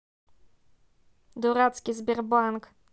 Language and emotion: Russian, angry